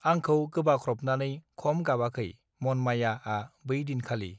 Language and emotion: Bodo, neutral